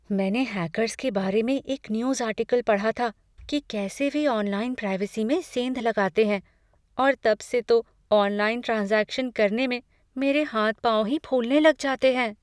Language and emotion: Hindi, fearful